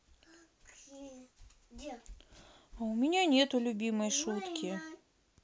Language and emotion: Russian, sad